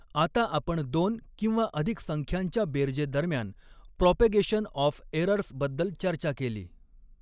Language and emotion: Marathi, neutral